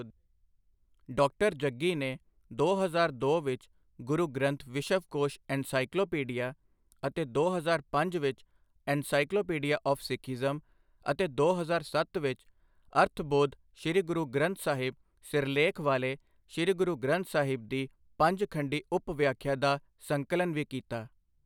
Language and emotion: Punjabi, neutral